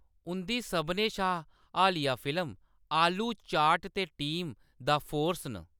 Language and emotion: Dogri, neutral